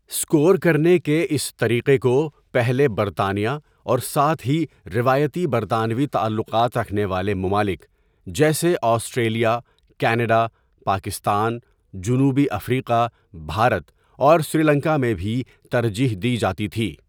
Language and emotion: Urdu, neutral